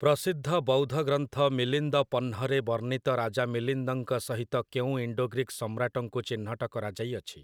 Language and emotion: Odia, neutral